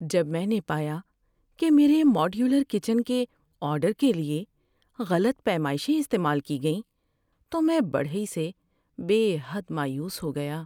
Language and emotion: Urdu, sad